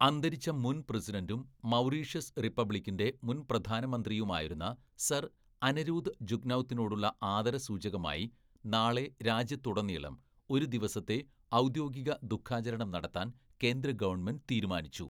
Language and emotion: Malayalam, neutral